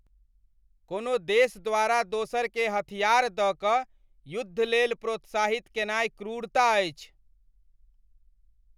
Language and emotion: Maithili, angry